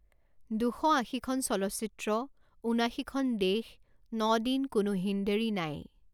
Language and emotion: Assamese, neutral